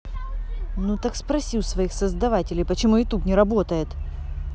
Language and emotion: Russian, angry